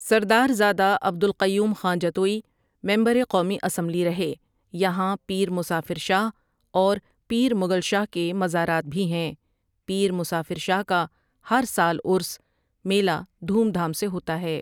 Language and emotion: Urdu, neutral